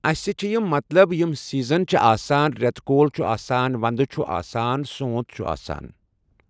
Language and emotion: Kashmiri, neutral